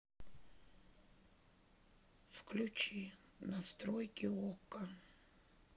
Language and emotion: Russian, sad